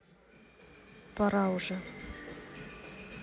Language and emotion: Russian, neutral